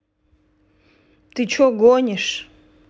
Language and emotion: Russian, angry